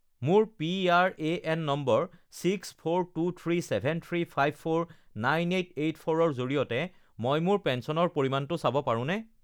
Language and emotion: Assamese, neutral